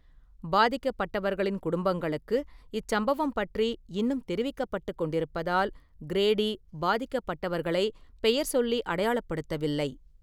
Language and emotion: Tamil, neutral